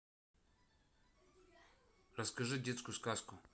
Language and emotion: Russian, neutral